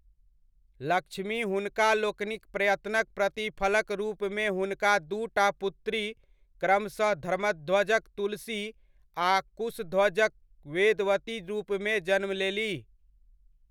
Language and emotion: Maithili, neutral